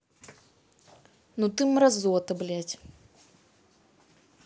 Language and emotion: Russian, angry